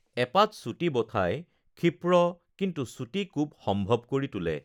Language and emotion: Assamese, neutral